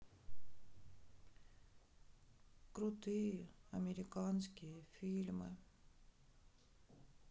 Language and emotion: Russian, sad